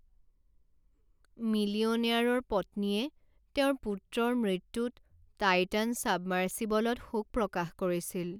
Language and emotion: Assamese, sad